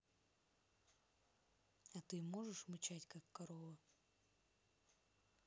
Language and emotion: Russian, neutral